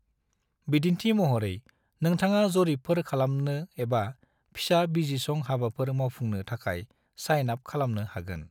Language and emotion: Bodo, neutral